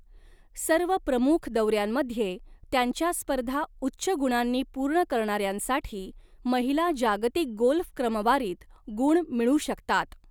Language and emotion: Marathi, neutral